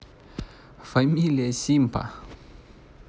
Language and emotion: Russian, neutral